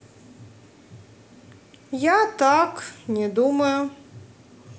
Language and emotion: Russian, neutral